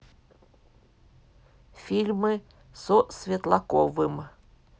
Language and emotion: Russian, neutral